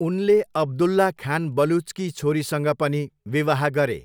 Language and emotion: Nepali, neutral